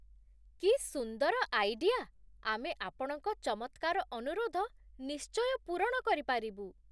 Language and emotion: Odia, surprised